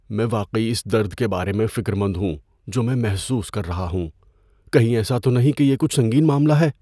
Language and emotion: Urdu, fearful